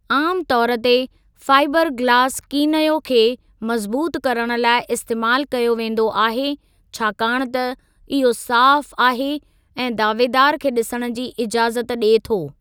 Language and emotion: Sindhi, neutral